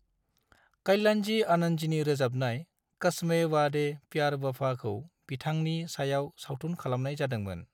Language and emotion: Bodo, neutral